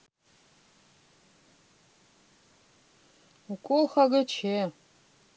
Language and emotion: Russian, neutral